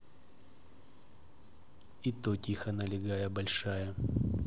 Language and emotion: Russian, neutral